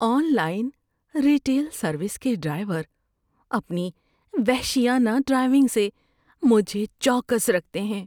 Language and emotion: Urdu, fearful